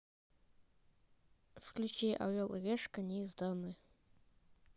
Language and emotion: Russian, neutral